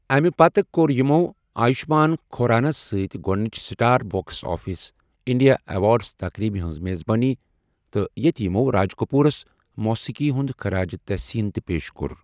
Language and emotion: Kashmiri, neutral